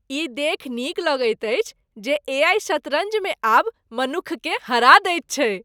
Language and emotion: Maithili, happy